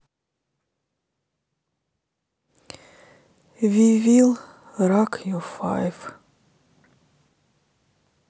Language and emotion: Russian, sad